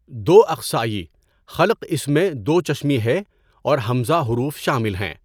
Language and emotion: Urdu, neutral